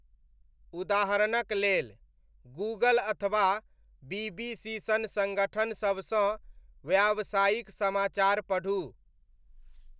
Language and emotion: Maithili, neutral